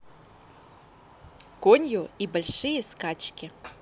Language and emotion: Russian, positive